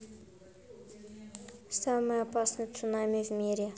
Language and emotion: Russian, neutral